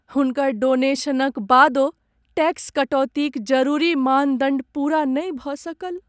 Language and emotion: Maithili, sad